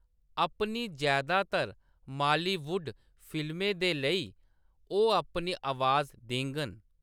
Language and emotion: Dogri, neutral